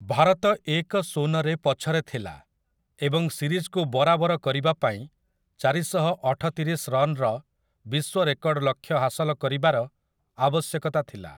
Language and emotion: Odia, neutral